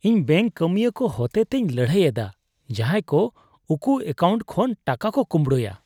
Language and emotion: Santali, disgusted